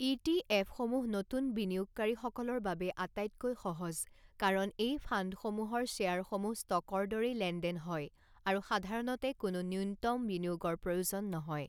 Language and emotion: Assamese, neutral